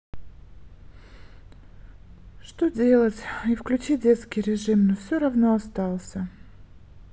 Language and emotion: Russian, sad